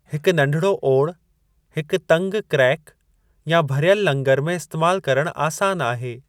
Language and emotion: Sindhi, neutral